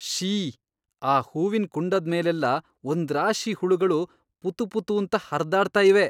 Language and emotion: Kannada, disgusted